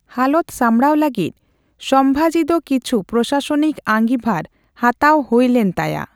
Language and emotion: Santali, neutral